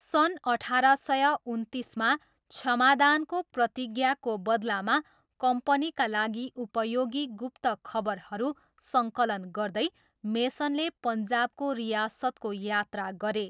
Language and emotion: Nepali, neutral